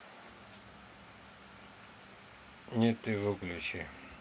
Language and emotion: Russian, neutral